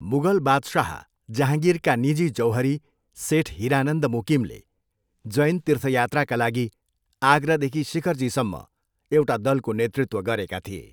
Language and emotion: Nepali, neutral